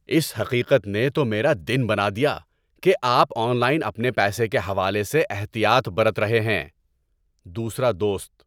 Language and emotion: Urdu, happy